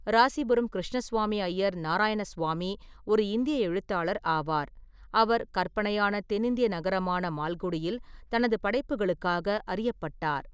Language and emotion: Tamil, neutral